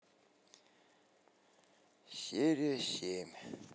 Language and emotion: Russian, sad